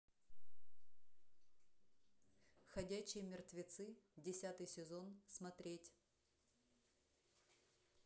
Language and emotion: Russian, neutral